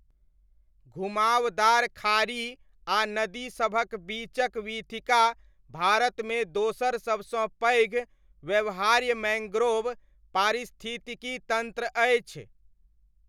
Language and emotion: Maithili, neutral